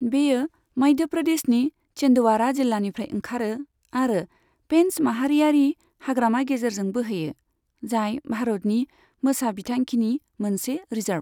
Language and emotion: Bodo, neutral